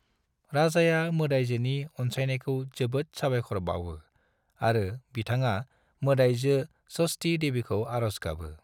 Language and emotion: Bodo, neutral